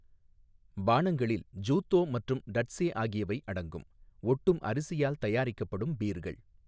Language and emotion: Tamil, neutral